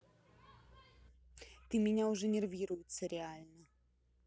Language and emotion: Russian, angry